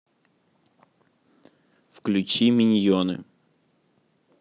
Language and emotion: Russian, neutral